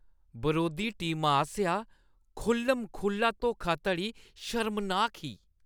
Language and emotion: Dogri, disgusted